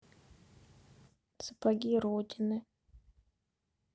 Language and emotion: Russian, neutral